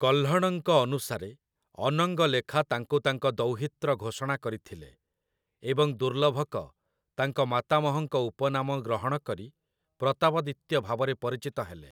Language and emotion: Odia, neutral